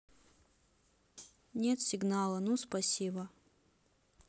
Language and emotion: Russian, sad